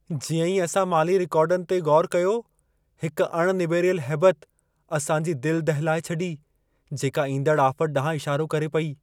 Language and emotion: Sindhi, fearful